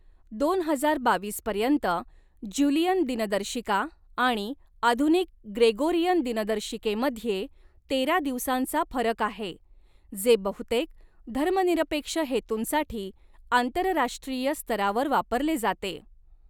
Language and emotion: Marathi, neutral